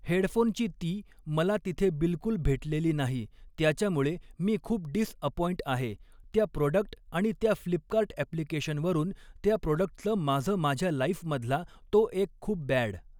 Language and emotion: Marathi, neutral